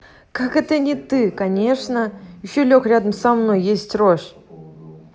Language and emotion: Russian, neutral